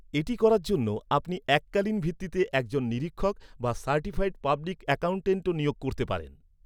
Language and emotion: Bengali, neutral